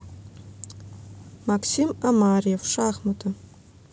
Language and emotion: Russian, neutral